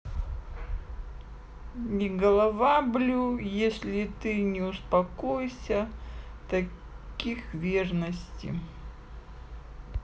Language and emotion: Russian, neutral